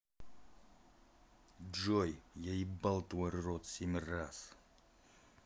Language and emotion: Russian, angry